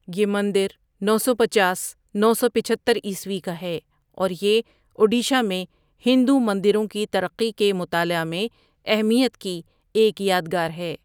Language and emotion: Urdu, neutral